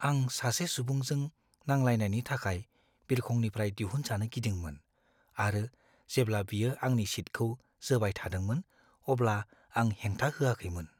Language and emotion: Bodo, fearful